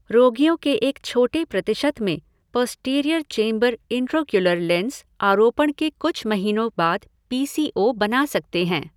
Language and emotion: Hindi, neutral